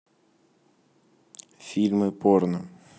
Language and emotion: Russian, neutral